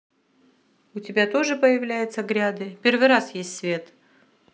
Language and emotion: Russian, neutral